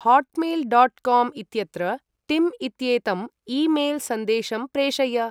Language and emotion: Sanskrit, neutral